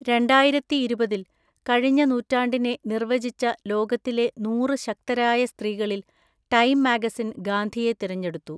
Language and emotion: Malayalam, neutral